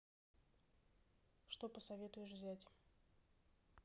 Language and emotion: Russian, neutral